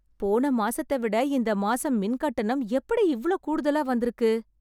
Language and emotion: Tamil, surprised